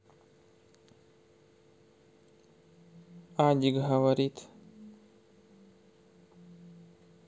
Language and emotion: Russian, neutral